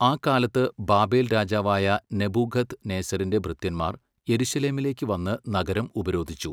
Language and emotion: Malayalam, neutral